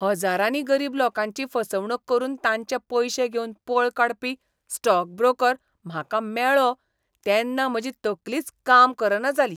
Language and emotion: Goan Konkani, disgusted